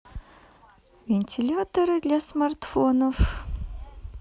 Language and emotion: Russian, neutral